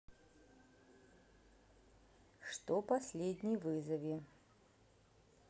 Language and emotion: Russian, neutral